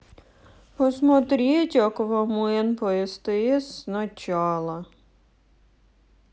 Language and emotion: Russian, sad